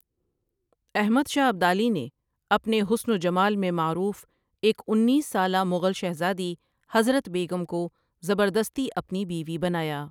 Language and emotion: Urdu, neutral